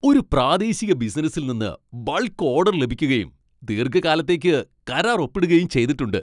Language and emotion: Malayalam, happy